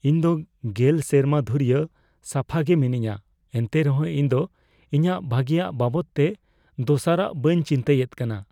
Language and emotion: Santali, fearful